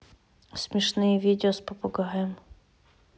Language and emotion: Russian, neutral